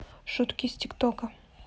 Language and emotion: Russian, neutral